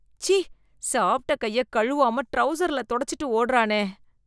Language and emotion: Tamil, disgusted